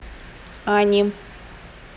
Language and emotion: Russian, neutral